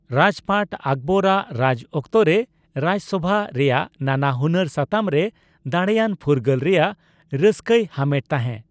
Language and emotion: Santali, neutral